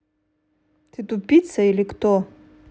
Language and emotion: Russian, angry